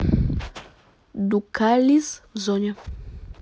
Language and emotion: Russian, neutral